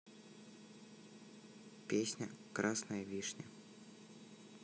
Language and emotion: Russian, neutral